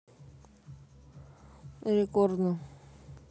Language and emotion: Russian, neutral